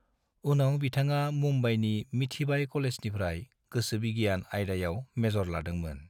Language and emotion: Bodo, neutral